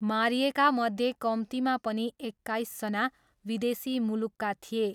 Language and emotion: Nepali, neutral